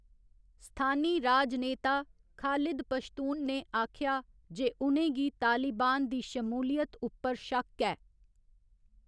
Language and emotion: Dogri, neutral